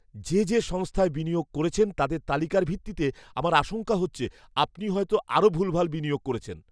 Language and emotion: Bengali, fearful